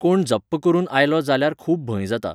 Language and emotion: Goan Konkani, neutral